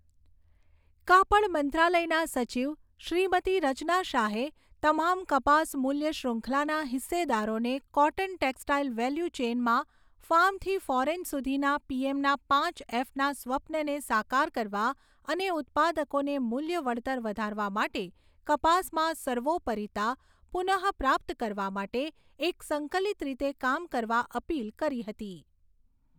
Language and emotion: Gujarati, neutral